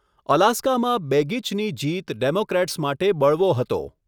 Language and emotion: Gujarati, neutral